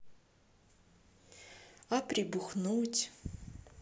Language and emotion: Russian, sad